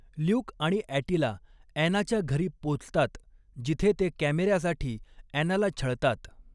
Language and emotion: Marathi, neutral